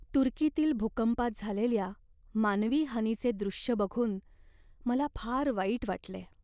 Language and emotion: Marathi, sad